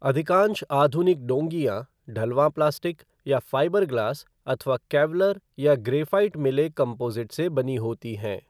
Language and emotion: Hindi, neutral